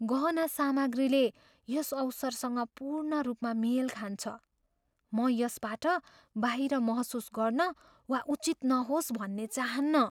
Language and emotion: Nepali, fearful